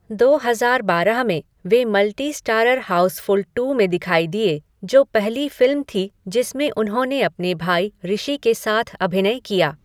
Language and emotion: Hindi, neutral